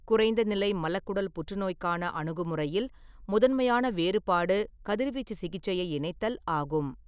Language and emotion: Tamil, neutral